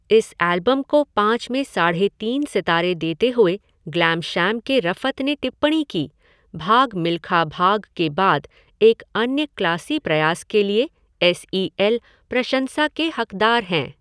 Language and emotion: Hindi, neutral